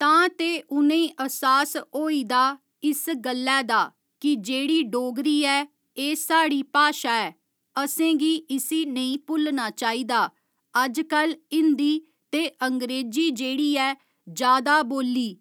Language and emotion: Dogri, neutral